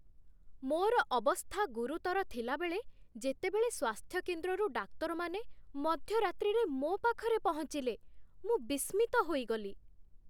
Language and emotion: Odia, surprised